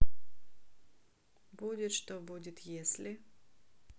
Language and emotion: Russian, neutral